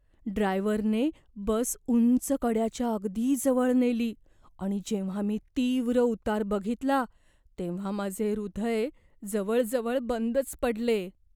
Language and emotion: Marathi, fearful